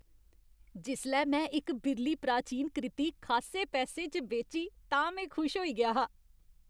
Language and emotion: Dogri, happy